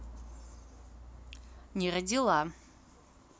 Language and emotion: Russian, neutral